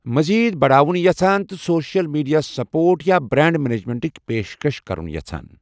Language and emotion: Kashmiri, neutral